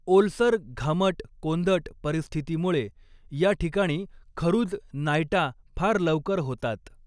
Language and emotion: Marathi, neutral